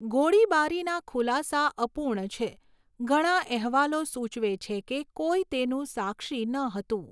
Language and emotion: Gujarati, neutral